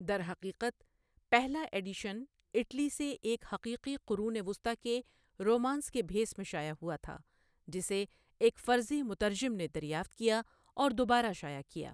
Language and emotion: Urdu, neutral